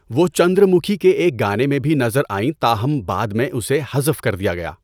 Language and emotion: Urdu, neutral